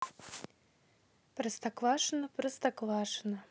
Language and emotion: Russian, neutral